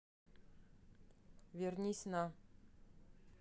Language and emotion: Russian, neutral